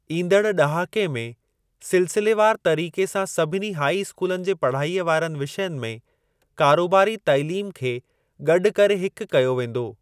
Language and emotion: Sindhi, neutral